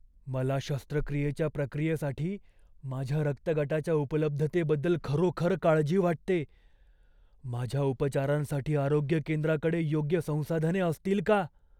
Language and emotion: Marathi, fearful